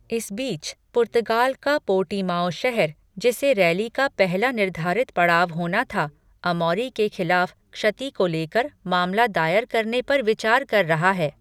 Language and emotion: Hindi, neutral